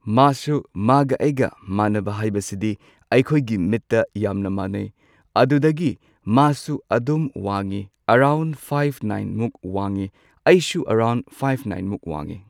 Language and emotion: Manipuri, neutral